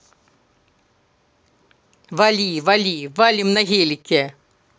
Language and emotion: Russian, angry